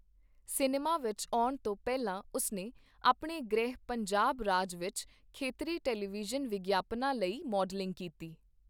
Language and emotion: Punjabi, neutral